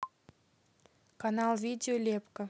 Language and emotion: Russian, neutral